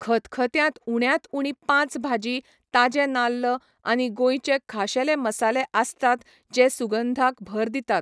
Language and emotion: Goan Konkani, neutral